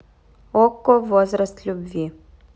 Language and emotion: Russian, neutral